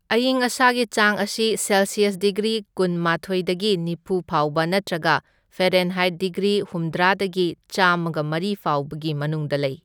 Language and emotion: Manipuri, neutral